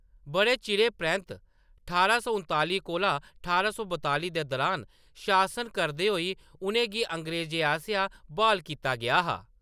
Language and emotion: Dogri, neutral